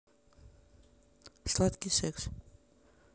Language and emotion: Russian, neutral